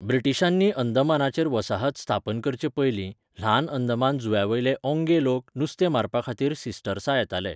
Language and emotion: Goan Konkani, neutral